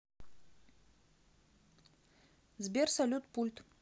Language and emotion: Russian, neutral